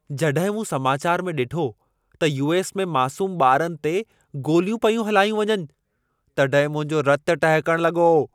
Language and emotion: Sindhi, angry